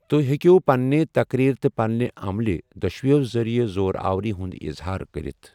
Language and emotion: Kashmiri, neutral